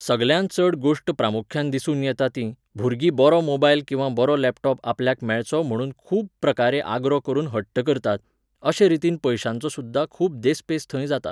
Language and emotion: Goan Konkani, neutral